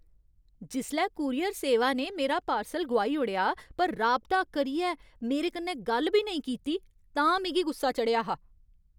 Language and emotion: Dogri, angry